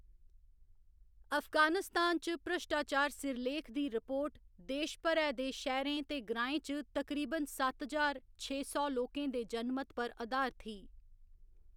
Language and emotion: Dogri, neutral